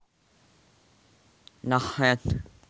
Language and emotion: Russian, neutral